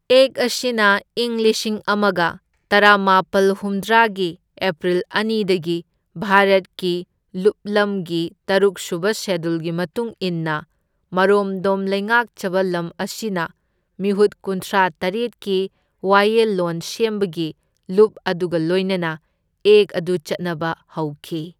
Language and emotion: Manipuri, neutral